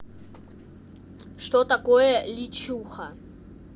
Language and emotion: Russian, neutral